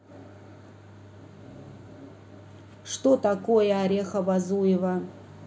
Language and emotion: Russian, neutral